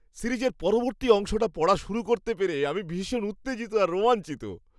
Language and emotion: Bengali, happy